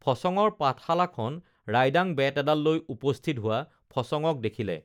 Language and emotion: Assamese, neutral